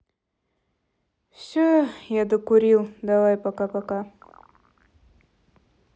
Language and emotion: Russian, sad